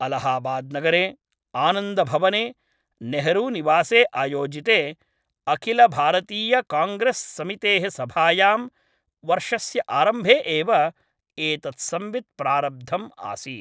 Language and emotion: Sanskrit, neutral